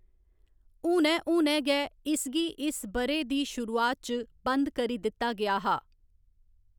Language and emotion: Dogri, neutral